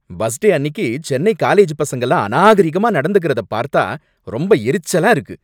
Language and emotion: Tamil, angry